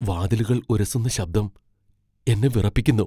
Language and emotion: Malayalam, fearful